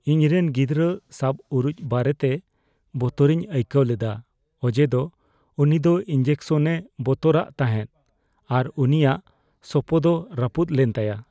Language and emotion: Santali, fearful